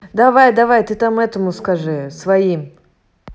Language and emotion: Russian, neutral